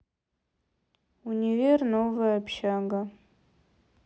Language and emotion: Russian, neutral